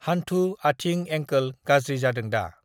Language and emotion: Bodo, neutral